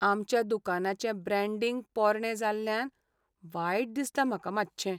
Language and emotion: Goan Konkani, sad